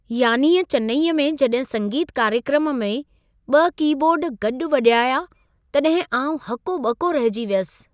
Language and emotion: Sindhi, surprised